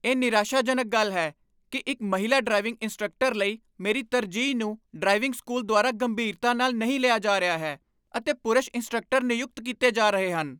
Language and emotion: Punjabi, angry